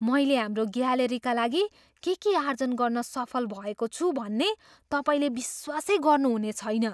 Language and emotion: Nepali, surprised